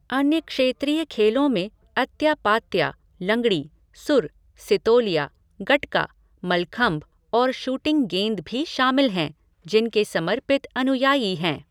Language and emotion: Hindi, neutral